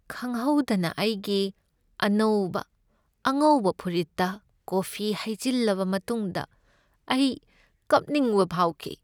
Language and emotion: Manipuri, sad